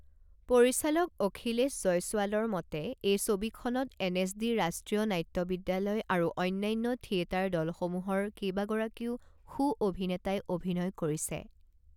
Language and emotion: Assamese, neutral